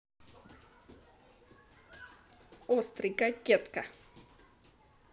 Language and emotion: Russian, positive